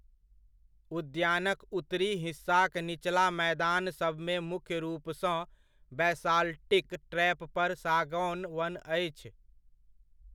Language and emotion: Maithili, neutral